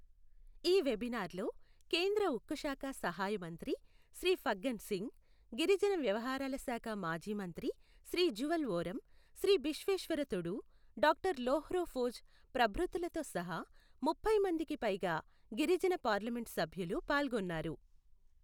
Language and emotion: Telugu, neutral